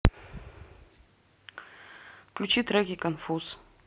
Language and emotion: Russian, neutral